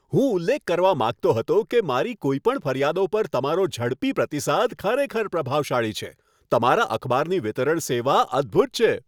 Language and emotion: Gujarati, happy